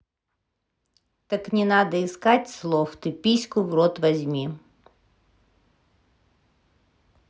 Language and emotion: Russian, neutral